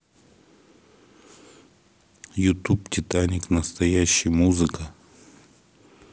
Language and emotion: Russian, neutral